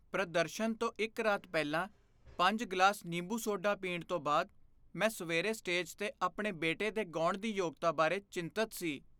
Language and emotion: Punjabi, fearful